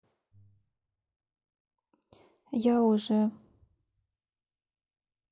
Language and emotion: Russian, sad